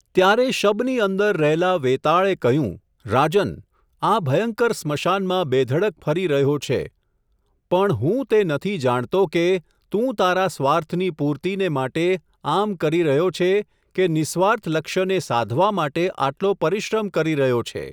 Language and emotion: Gujarati, neutral